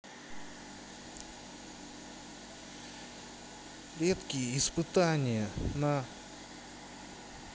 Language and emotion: Russian, neutral